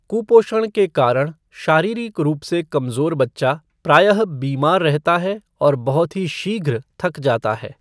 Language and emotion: Hindi, neutral